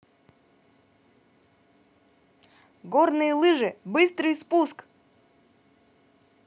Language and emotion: Russian, positive